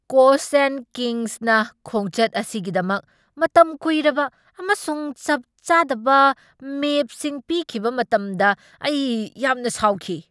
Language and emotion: Manipuri, angry